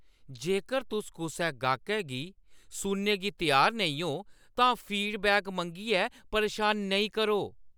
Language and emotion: Dogri, angry